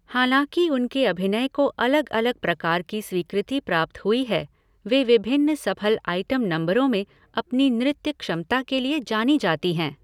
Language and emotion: Hindi, neutral